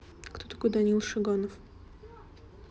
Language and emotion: Russian, neutral